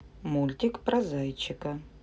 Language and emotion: Russian, neutral